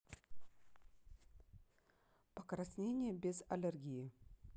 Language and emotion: Russian, neutral